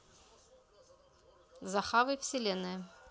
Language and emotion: Russian, neutral